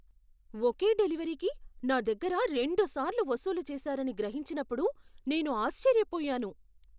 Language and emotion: Telugu, surprised